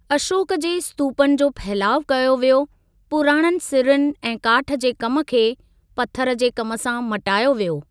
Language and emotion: Sindhi, neutral